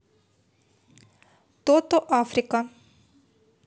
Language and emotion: Russian, neutral